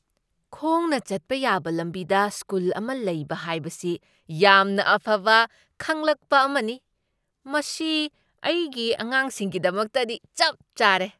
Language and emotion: Manipuri, surprised